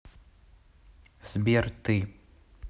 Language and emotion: Russian, neutral